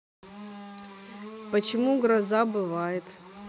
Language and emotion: Russian, neutral